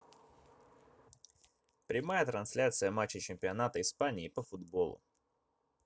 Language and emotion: Russian, neutral